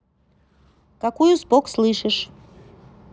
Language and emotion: Russian, neutral